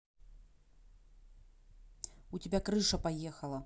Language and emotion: Russian, angry